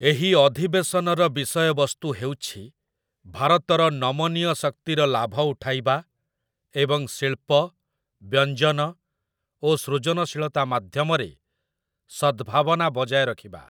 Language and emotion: Odia, neutral